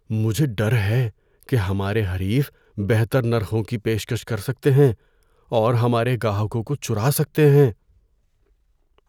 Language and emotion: Urdu, fearful